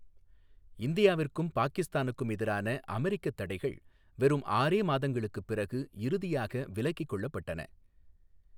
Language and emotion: Tamil, neutral